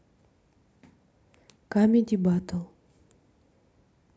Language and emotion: Russian, neutral